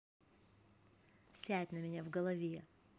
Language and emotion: Russian, neutral